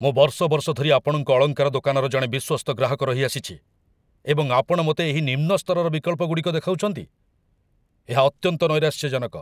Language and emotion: Odia, angry